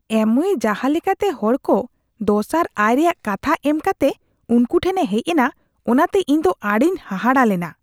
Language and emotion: Santali, disgusted